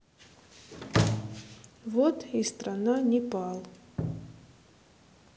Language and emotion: Russian, neutral